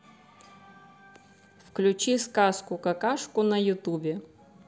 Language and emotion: Russian, neutral